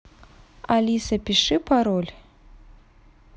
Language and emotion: Russian, neutral